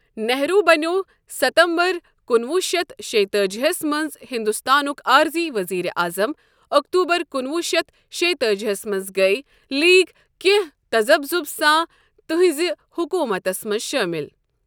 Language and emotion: Kashmiri, neutral